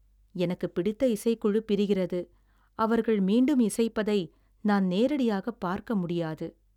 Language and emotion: Tamil, sad